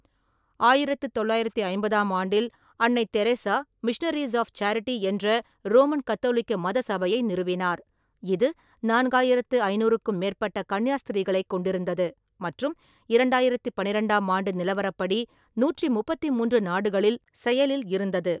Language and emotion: Tamil, neutral